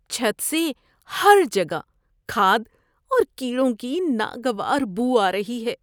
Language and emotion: Urdu, disgusted